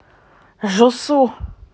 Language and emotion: Russian, neutral